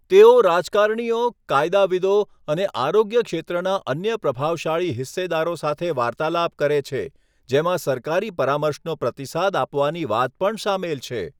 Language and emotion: Gujarati, neutral